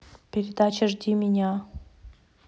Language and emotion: Russian, neutral